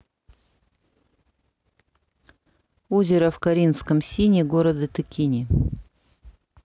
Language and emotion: Russian, neutral